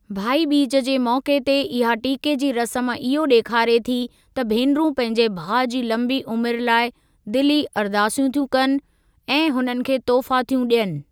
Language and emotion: Sindhi, neutral